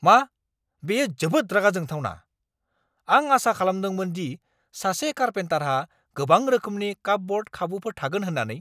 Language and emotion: Bodo, angry